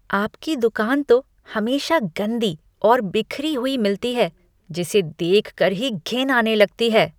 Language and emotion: Hindi, disgusted